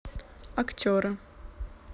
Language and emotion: Russian, neutral